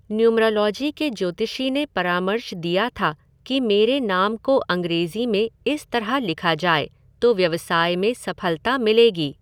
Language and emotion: Hindi, neutral